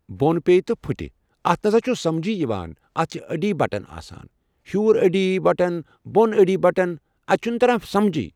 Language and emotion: Kashmiri, neutral